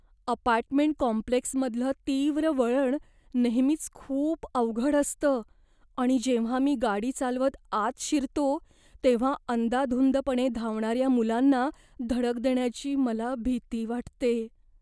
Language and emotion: Marathi, fearful